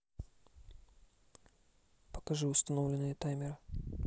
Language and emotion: Russian, neutral